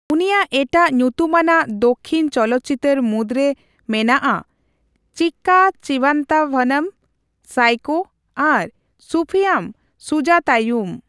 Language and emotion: Santali, neutral